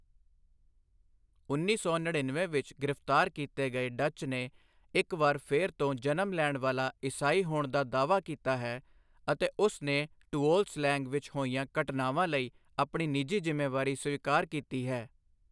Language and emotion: Punjabi, neutral